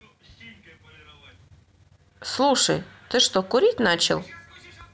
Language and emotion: Russian, neutral